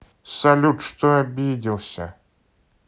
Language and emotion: Russian, neutral